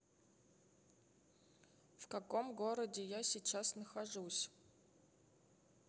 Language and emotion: Russian, neutral